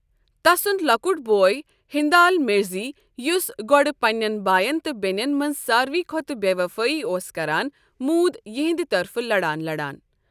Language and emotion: Kashmiri, neutral